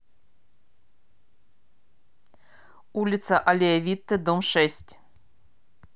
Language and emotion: Russian, neutral